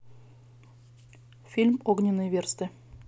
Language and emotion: Russian, neutral